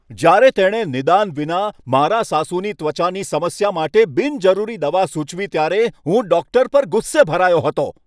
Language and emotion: Gujarati, angry